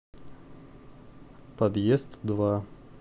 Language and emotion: Russian, neutral